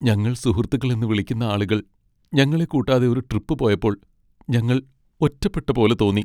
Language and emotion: Malayalam, sad